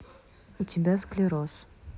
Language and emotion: Russian, neutral